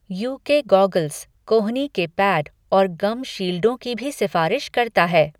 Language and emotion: Hindi, neutral